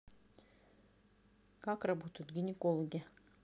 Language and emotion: Russian, neutral